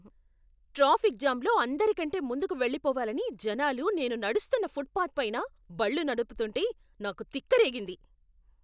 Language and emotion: Telugu, angry